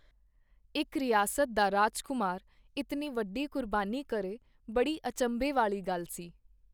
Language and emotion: Punjabi, neutral